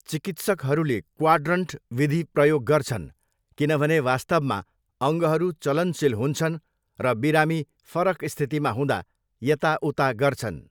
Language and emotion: Nepali, neutral